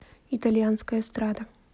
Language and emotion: Russian, neutral